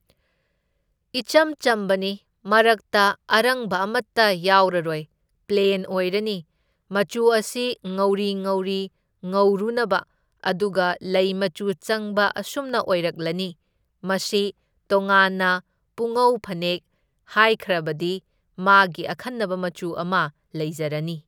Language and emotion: Manipuri, neutral